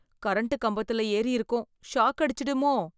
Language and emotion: Tamil, fearful